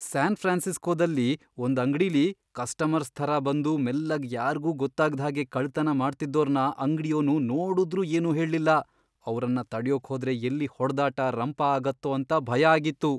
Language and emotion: Kannada, fearful